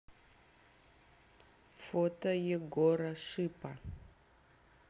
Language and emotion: Russian, neutral